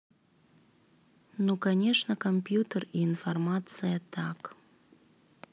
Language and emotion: Russian, neutral